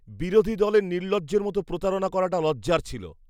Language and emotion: Bengali, disgusted